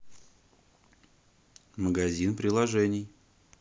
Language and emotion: Russian, neutral